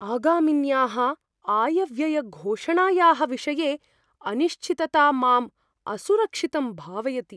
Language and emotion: Sanskrit, fearful